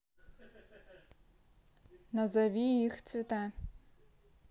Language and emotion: Russian, neutral